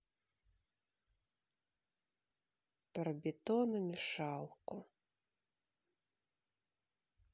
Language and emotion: Russian, sad